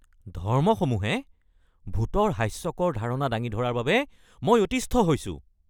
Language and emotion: Assamese, angry